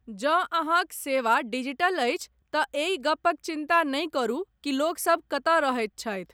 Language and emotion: Maithili, neutral